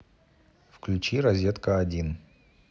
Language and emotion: Russian, neutral